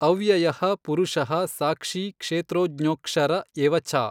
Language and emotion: Kannada, neutral